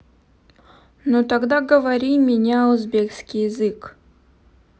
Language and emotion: Russian, neutral